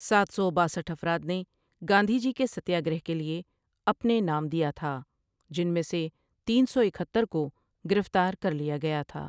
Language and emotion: Urdu, neutral